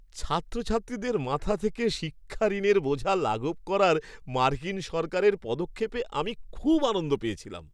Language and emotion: Bengali, happy